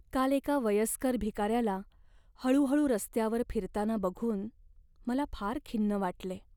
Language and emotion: Marathi, sad